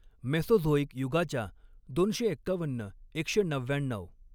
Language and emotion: Marathi, neutral